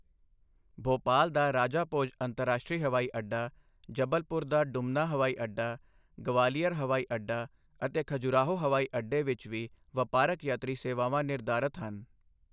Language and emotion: Punjabi, neutral